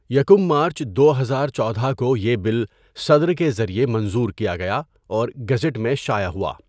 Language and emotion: Urdu, neutral